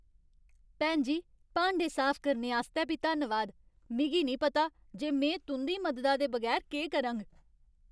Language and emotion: Dogri, happy